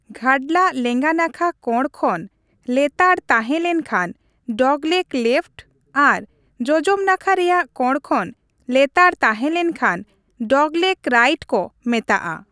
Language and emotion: Santali, neutral